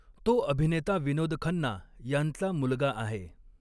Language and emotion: Marathi, neutral